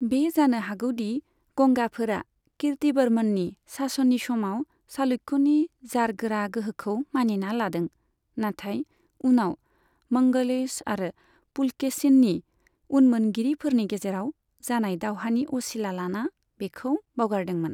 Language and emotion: Bodo, neutral